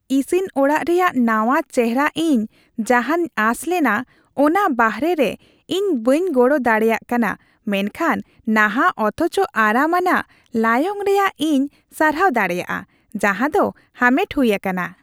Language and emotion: Santali, happy